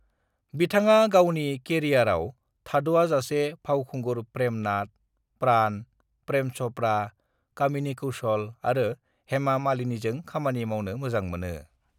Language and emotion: Bodo, neutral